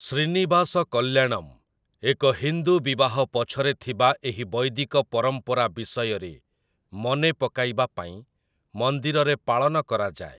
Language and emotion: Odia, neutral